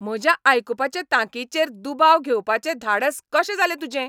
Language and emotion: Goan Konkani, angry